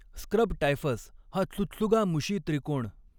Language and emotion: Marathi, neutral